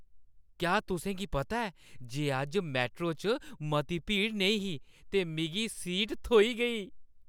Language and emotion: Dogri, happy